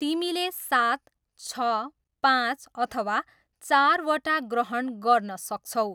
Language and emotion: Nepali, neutral